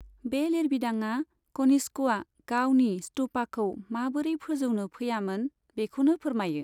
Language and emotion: Bodo, neutral